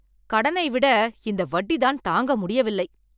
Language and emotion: Tamil, angry